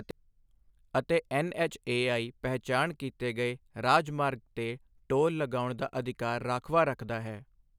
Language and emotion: Punjabi, neutral